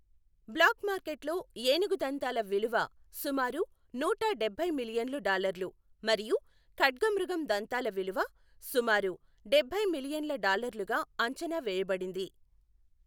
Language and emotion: Telugu, neutral